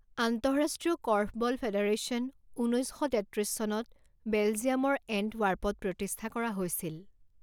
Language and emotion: Assamese, neutral